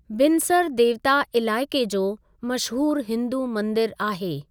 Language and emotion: Sindhi, neutral